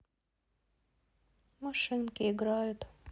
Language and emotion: Russian, sad